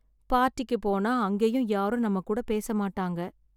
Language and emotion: Tamil, sad